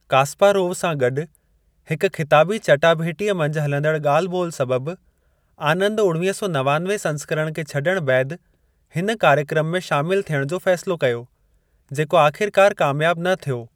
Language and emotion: Sindhi, neutral